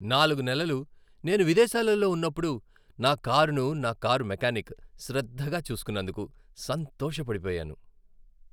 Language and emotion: Telugu, happy